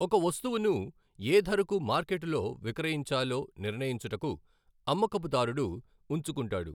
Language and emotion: Telugu, neutral